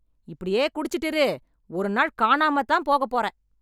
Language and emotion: Tamil, angry